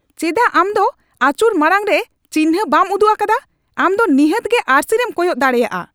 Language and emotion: Santali, angry